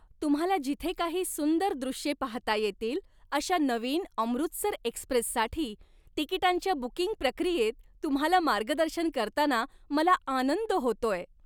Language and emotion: Marathi, happy